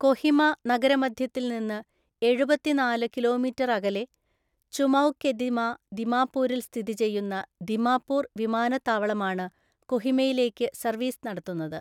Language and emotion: Malayalam, neutral